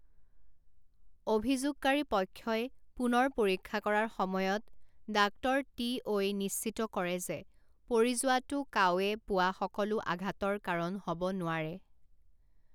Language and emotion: Assamese, neutral